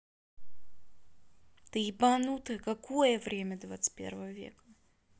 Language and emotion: Russian, angry